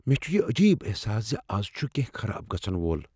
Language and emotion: Kashmiri, fearful